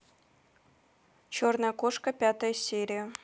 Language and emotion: Russian, neutral